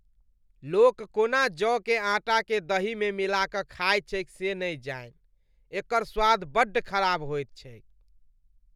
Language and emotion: Maithili, disgusted